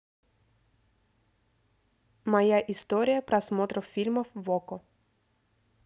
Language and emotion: Russian, neutral